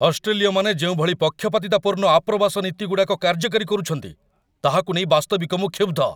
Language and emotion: Odia, angry